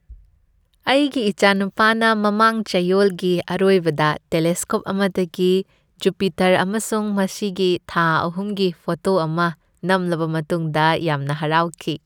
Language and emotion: Manipuri, happy